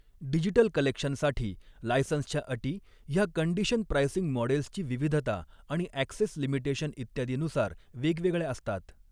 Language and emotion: Marathi, neutral